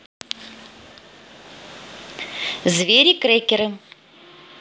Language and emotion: Russian, positive